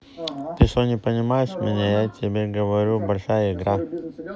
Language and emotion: Russian, neutral